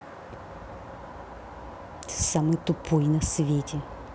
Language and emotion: Russian, angry